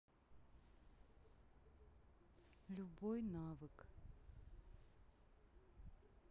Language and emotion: Russian, sad